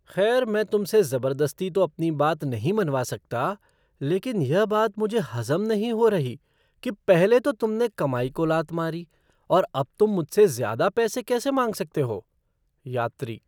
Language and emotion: Hindi, surprised